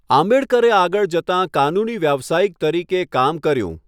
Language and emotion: Gujarati, neutral